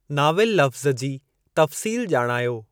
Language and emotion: Sindhi, neutral